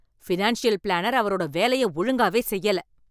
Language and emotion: Tamil, angry